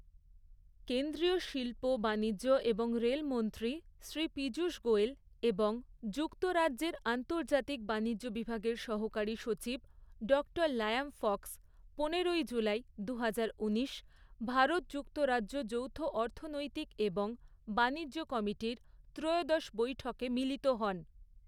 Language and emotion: Bengali, neutral